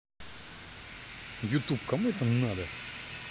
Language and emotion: Russian, angry